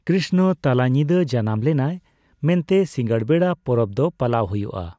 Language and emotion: Santali, neutral